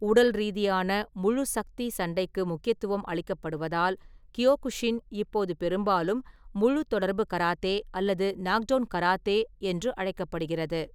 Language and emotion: Tamil, neutral